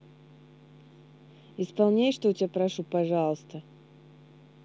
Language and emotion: Russian, neutral